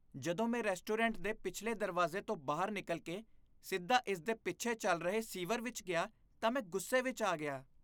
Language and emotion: Punjabi, disgusted